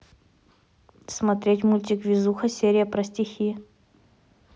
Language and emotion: Russian, neutral